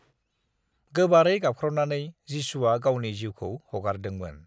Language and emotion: Bodo, neutral